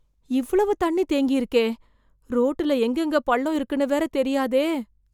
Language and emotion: Tamil, fearful